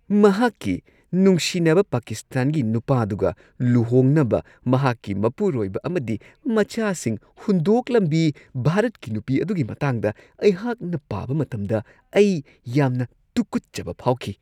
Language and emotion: Manipuri, disgusted